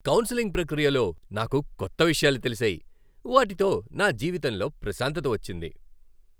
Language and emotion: Telugu, happy